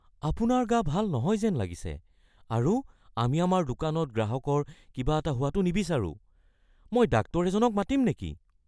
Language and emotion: Assamese, fearful